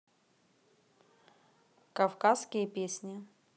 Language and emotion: Russian, neutral